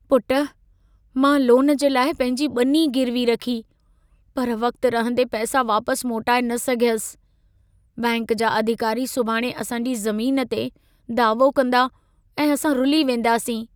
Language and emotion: Sindhi, sad